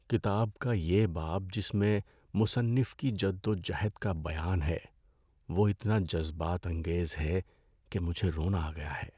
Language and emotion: Urdu, sad